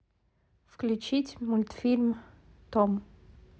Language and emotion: Russian, neutral